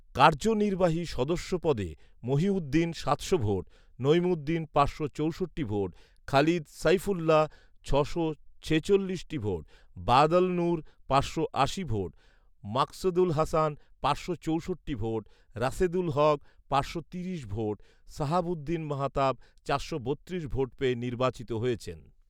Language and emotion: Bengali, neutral